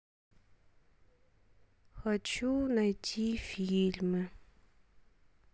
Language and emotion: Russian, sad